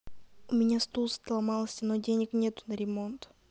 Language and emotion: Russian, sad